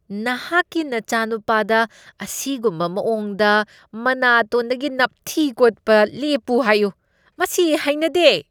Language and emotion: Manipuri, disgusted